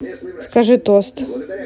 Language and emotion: Russian, neutral